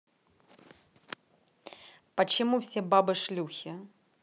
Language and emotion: Russian, angry